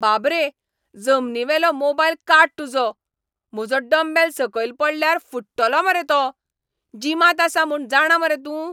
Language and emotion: Goan Konkani, angry